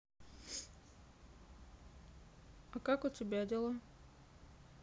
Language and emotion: Russian, neutral